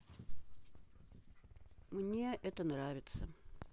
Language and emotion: Russian, neutral